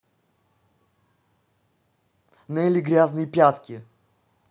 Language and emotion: Russian, neutral